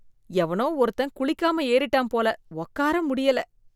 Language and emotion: Tamil, disgusted